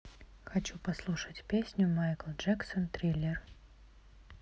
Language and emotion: Russian, neutral